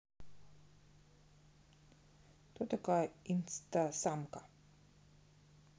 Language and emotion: Russian, neutral